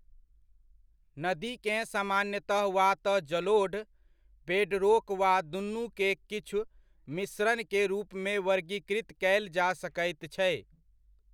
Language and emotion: Maithili, neutral